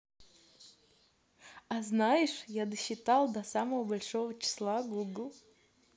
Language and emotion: Russian, positive